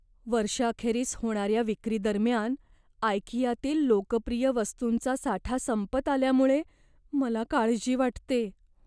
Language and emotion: Marathi, fearful